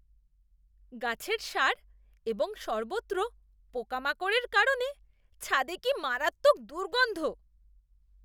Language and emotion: Bengali, disgusted